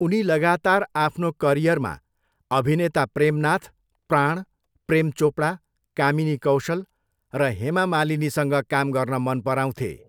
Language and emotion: Nepali, neutral